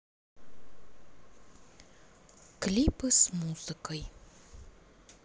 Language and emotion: Russian, neutral